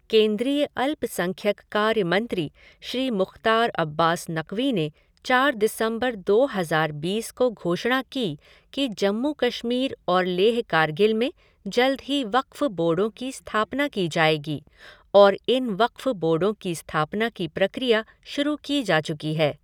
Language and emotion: Hindi, neutral